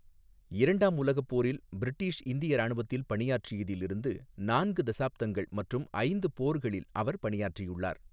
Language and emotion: Tamil, neutral